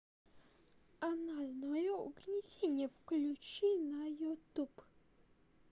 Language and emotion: Russian, neutral